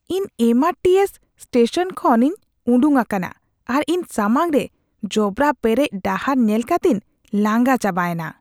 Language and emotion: Santali, disgusted